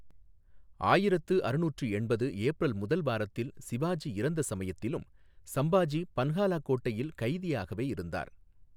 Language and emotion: Tamil, neutral